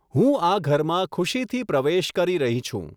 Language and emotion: Gujarati, neutral